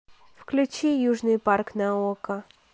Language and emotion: Russian, neutral